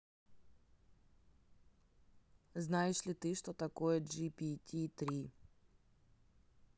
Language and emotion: Russian, neutral